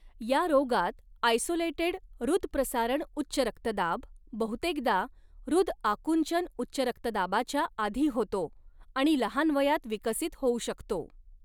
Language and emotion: Marathi, neutral